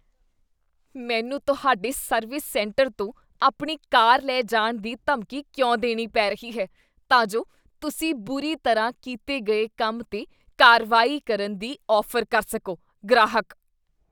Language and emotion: Punjabi, disgusted